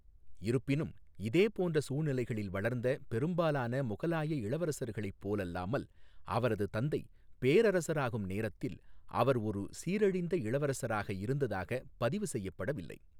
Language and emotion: Tamil, neutral